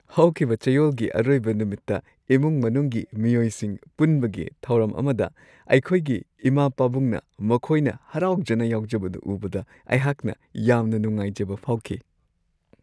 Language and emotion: Manipuri, happy